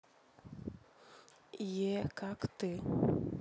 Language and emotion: Russian, neutral